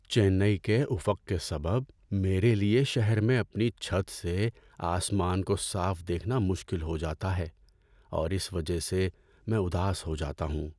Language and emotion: Urdu, sad